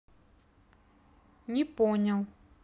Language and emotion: Russian, neutral